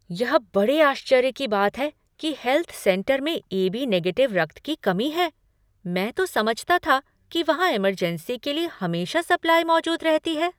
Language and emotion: Hindi, surprised